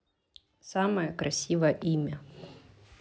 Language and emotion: Russian, neutral